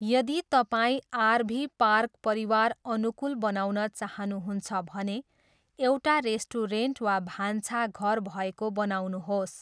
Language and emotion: Nepali, neutral